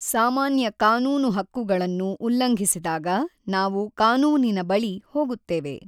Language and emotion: Kannada, neutral